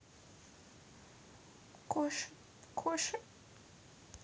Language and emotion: Russian, sad